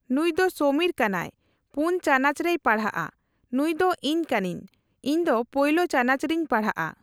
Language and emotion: Santali, neutral